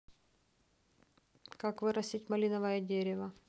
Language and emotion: Russian, neutral